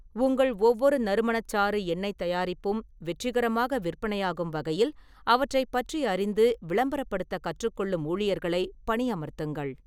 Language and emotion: Tamil, neutral